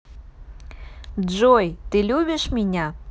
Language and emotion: Russian, positive